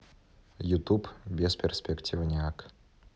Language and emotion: Russian, neutral